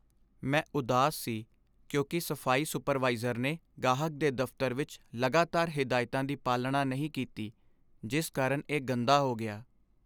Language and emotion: Punjabi, sad